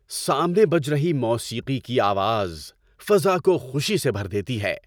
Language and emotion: Urdu, happy